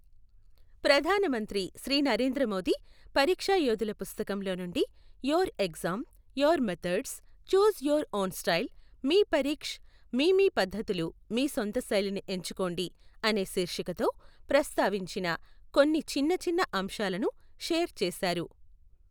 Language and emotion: Telugu, neutral